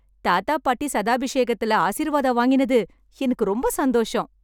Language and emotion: Tamil, happy